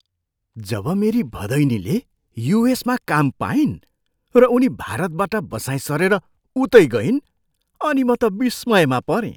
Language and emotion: Nepali, surprised